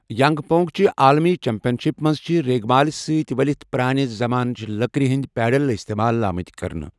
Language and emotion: Kashmiri, neutral